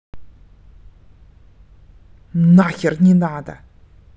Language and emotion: Russian, angry